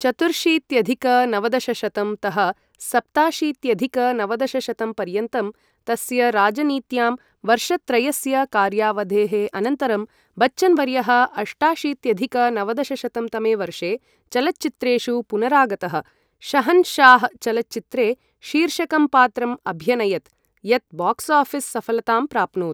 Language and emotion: Sanskrit, neutral